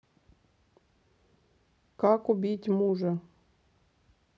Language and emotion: Russian, neutral